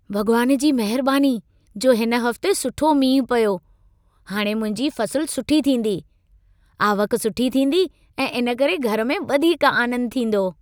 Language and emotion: Sindhi, happy